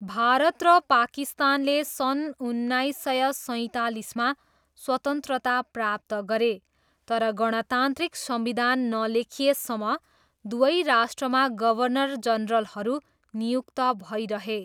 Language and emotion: Nepali, neutral